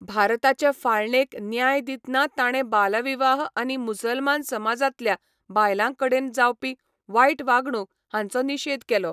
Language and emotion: Goan Konkani, neutral